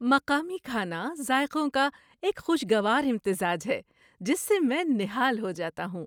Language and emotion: Urdu, happy